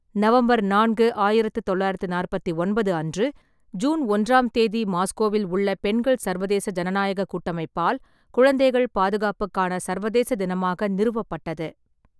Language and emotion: Tamil, neutral